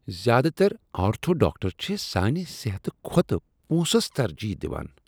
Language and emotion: Kashmiri, disgusted